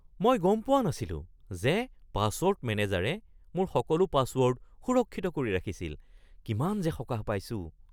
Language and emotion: Assamese, surprised